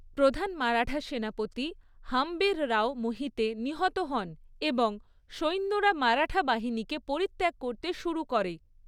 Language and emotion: Bengali, neutral